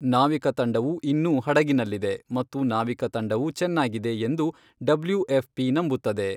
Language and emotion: Kannada, neutral